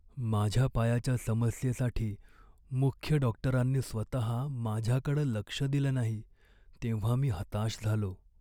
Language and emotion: Marathi, sad